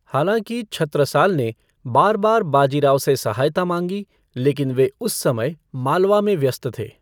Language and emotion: Hindi, neutral